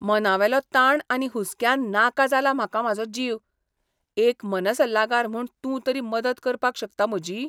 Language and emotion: Goan Konkani, disgusted